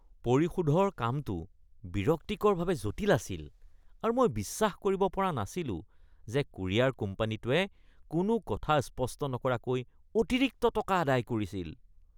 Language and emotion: Assamese, disgusted